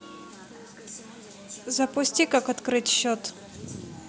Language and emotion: Russian, neutral